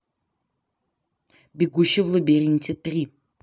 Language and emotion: Russian, neutral